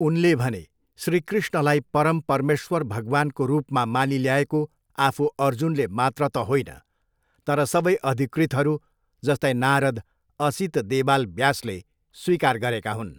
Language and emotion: Nepali, neutral